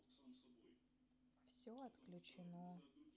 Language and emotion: Russian, sad